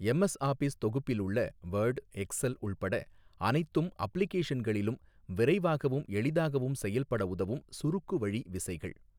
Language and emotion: Tamil, neutral